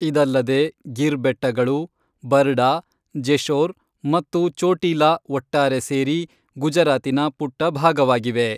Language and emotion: Kannada, neutral